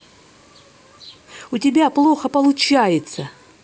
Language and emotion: Russian, angry